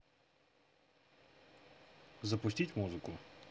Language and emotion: Russian, neutral